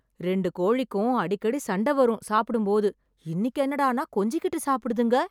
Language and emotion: Tamil, surprised